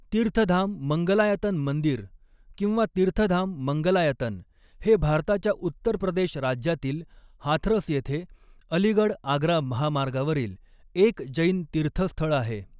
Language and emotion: Marathi, neutral